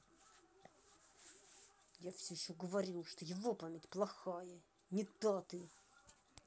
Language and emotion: Russian, angry